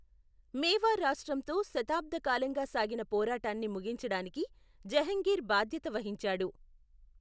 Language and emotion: Telugu, neutral